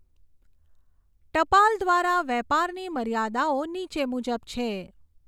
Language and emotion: Gujarati, neutral